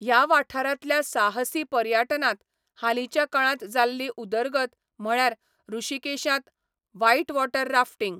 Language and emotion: Goan Konkani, neutral